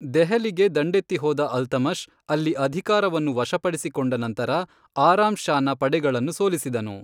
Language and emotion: Kannada, neutral